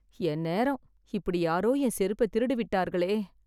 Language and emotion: Tamil, sad